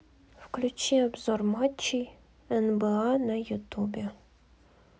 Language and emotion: Russian, neutral